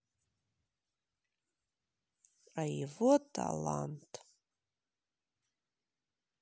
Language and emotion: Russian, sad